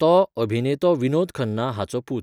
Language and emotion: Goan Konkani, neutral